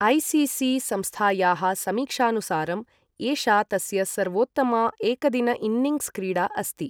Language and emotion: Sanskrit, neutral